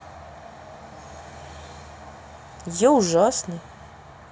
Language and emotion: Russian, neutral